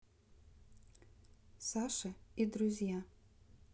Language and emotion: Russian, neutral